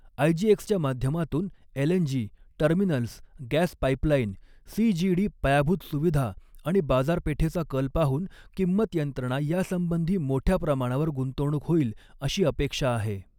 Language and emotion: Marathi, neutral